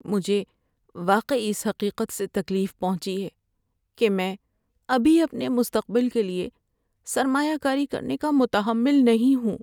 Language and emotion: Urdu, sad